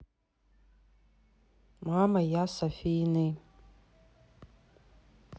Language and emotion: Russian, neutral